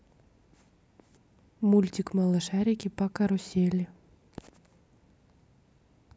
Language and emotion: Russian, neutral